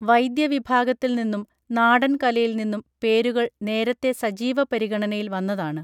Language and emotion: Malayalam, neutral